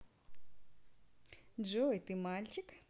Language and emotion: Russian, positive